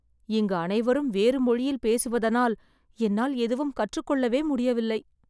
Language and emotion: Tamil, sad